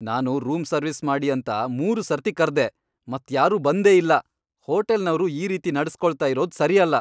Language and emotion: Kannada, angry